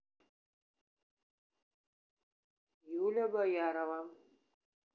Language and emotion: Russian, neutral